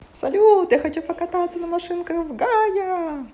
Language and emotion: Russian, positive